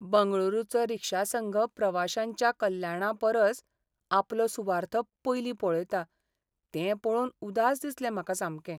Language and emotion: Goan Konkani, sad